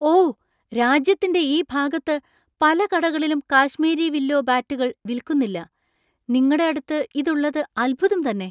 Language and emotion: Malayalam, surprised